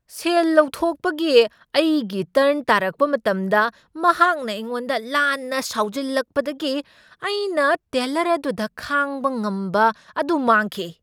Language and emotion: Manipuri, angry